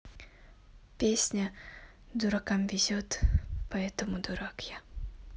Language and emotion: Russian, neutral